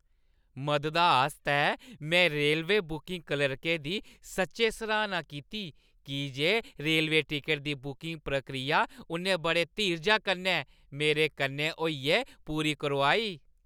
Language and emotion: Dogri, happy